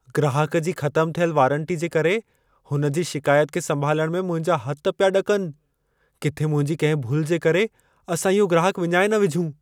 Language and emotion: Sindhi, fearful